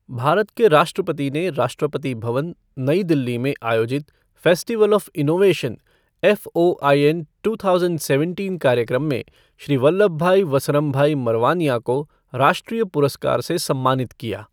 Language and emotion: Hindi, neutral